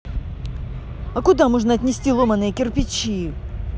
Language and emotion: Russian, neutral